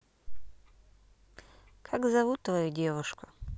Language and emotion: Russian, neutral